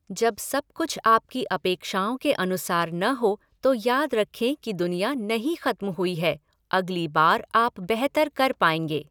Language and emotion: Hindi, neutral